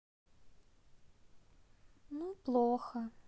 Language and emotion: Russian, sad